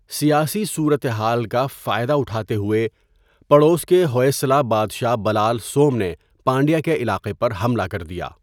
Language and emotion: Urdu, neutral